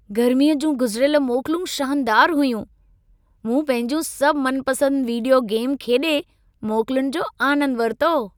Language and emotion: Sindhi, happy